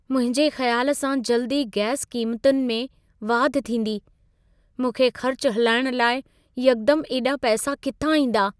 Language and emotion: Sindhi, fearful